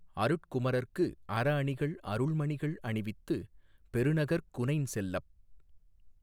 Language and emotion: Tamil, neutral